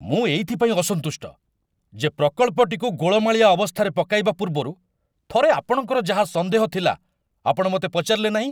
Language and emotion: Odia, angry